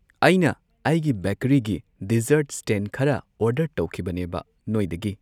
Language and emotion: Manipuri, neutral